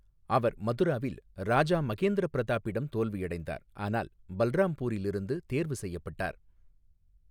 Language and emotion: Tamil, neutral